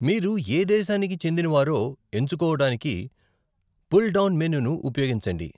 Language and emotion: Telugu, neutral